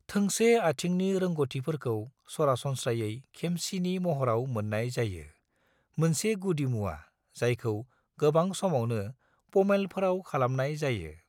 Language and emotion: Bodo, neutral